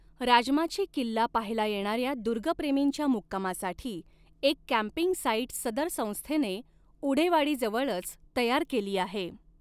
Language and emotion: Marathi, neutral